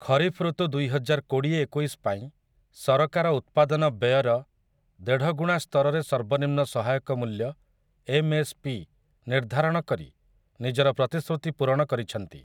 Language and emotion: Odia, neutral